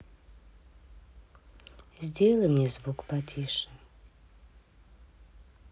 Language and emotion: Russian, sad